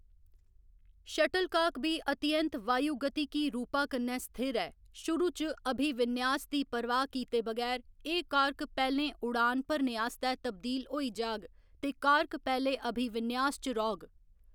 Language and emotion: Dogri, neutral